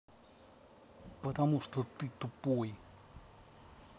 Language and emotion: Russian, angry